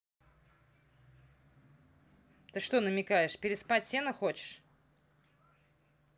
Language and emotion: Russian, angry